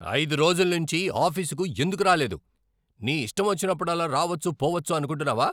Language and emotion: Telugu, angry